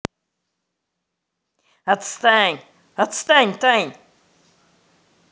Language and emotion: Russian, angry